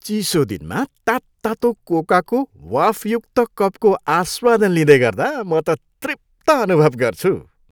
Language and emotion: Nepali, happy